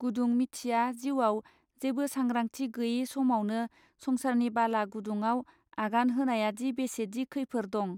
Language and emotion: Bodo, neutral